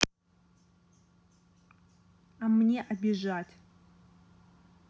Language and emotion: Russian, neutral